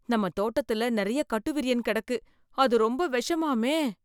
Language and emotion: Tamil, fearful